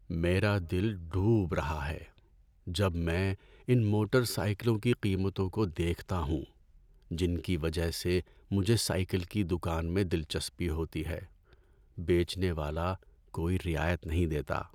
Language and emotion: Urdu, sad